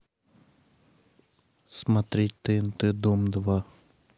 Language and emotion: Russian, neutral